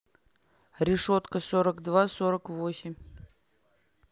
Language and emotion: Russian, neutral